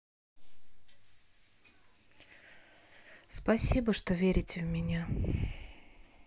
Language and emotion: Russian, sad